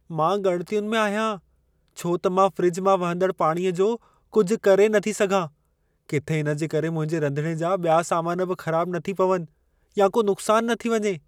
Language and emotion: Sindhi, fearful